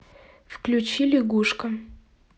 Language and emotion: Russian, neutral